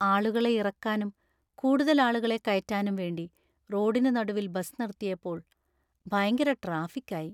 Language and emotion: Malayalam, sad